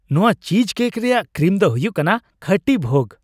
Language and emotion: Santali, happy